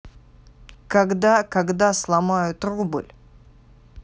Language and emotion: Russian, angry